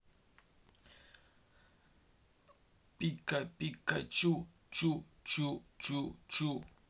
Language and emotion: Russian, neutral